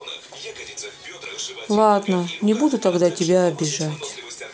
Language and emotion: Russian, sad